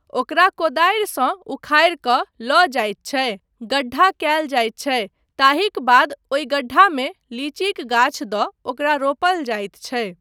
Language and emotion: Maithili, neutral